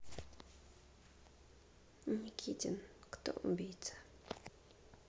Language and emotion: Russian, neutral